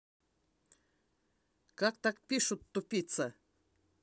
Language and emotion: Russian, angry